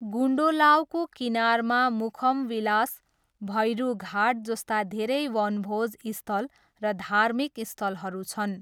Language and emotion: Nepali, neutral